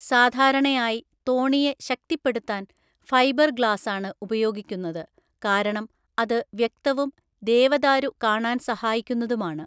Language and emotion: Malayalam, neutral